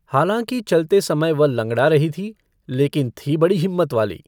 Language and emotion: Hindi, neutral